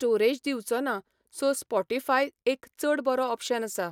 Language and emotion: Goan Konkani, neutral